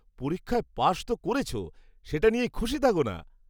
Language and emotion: Bengali, happy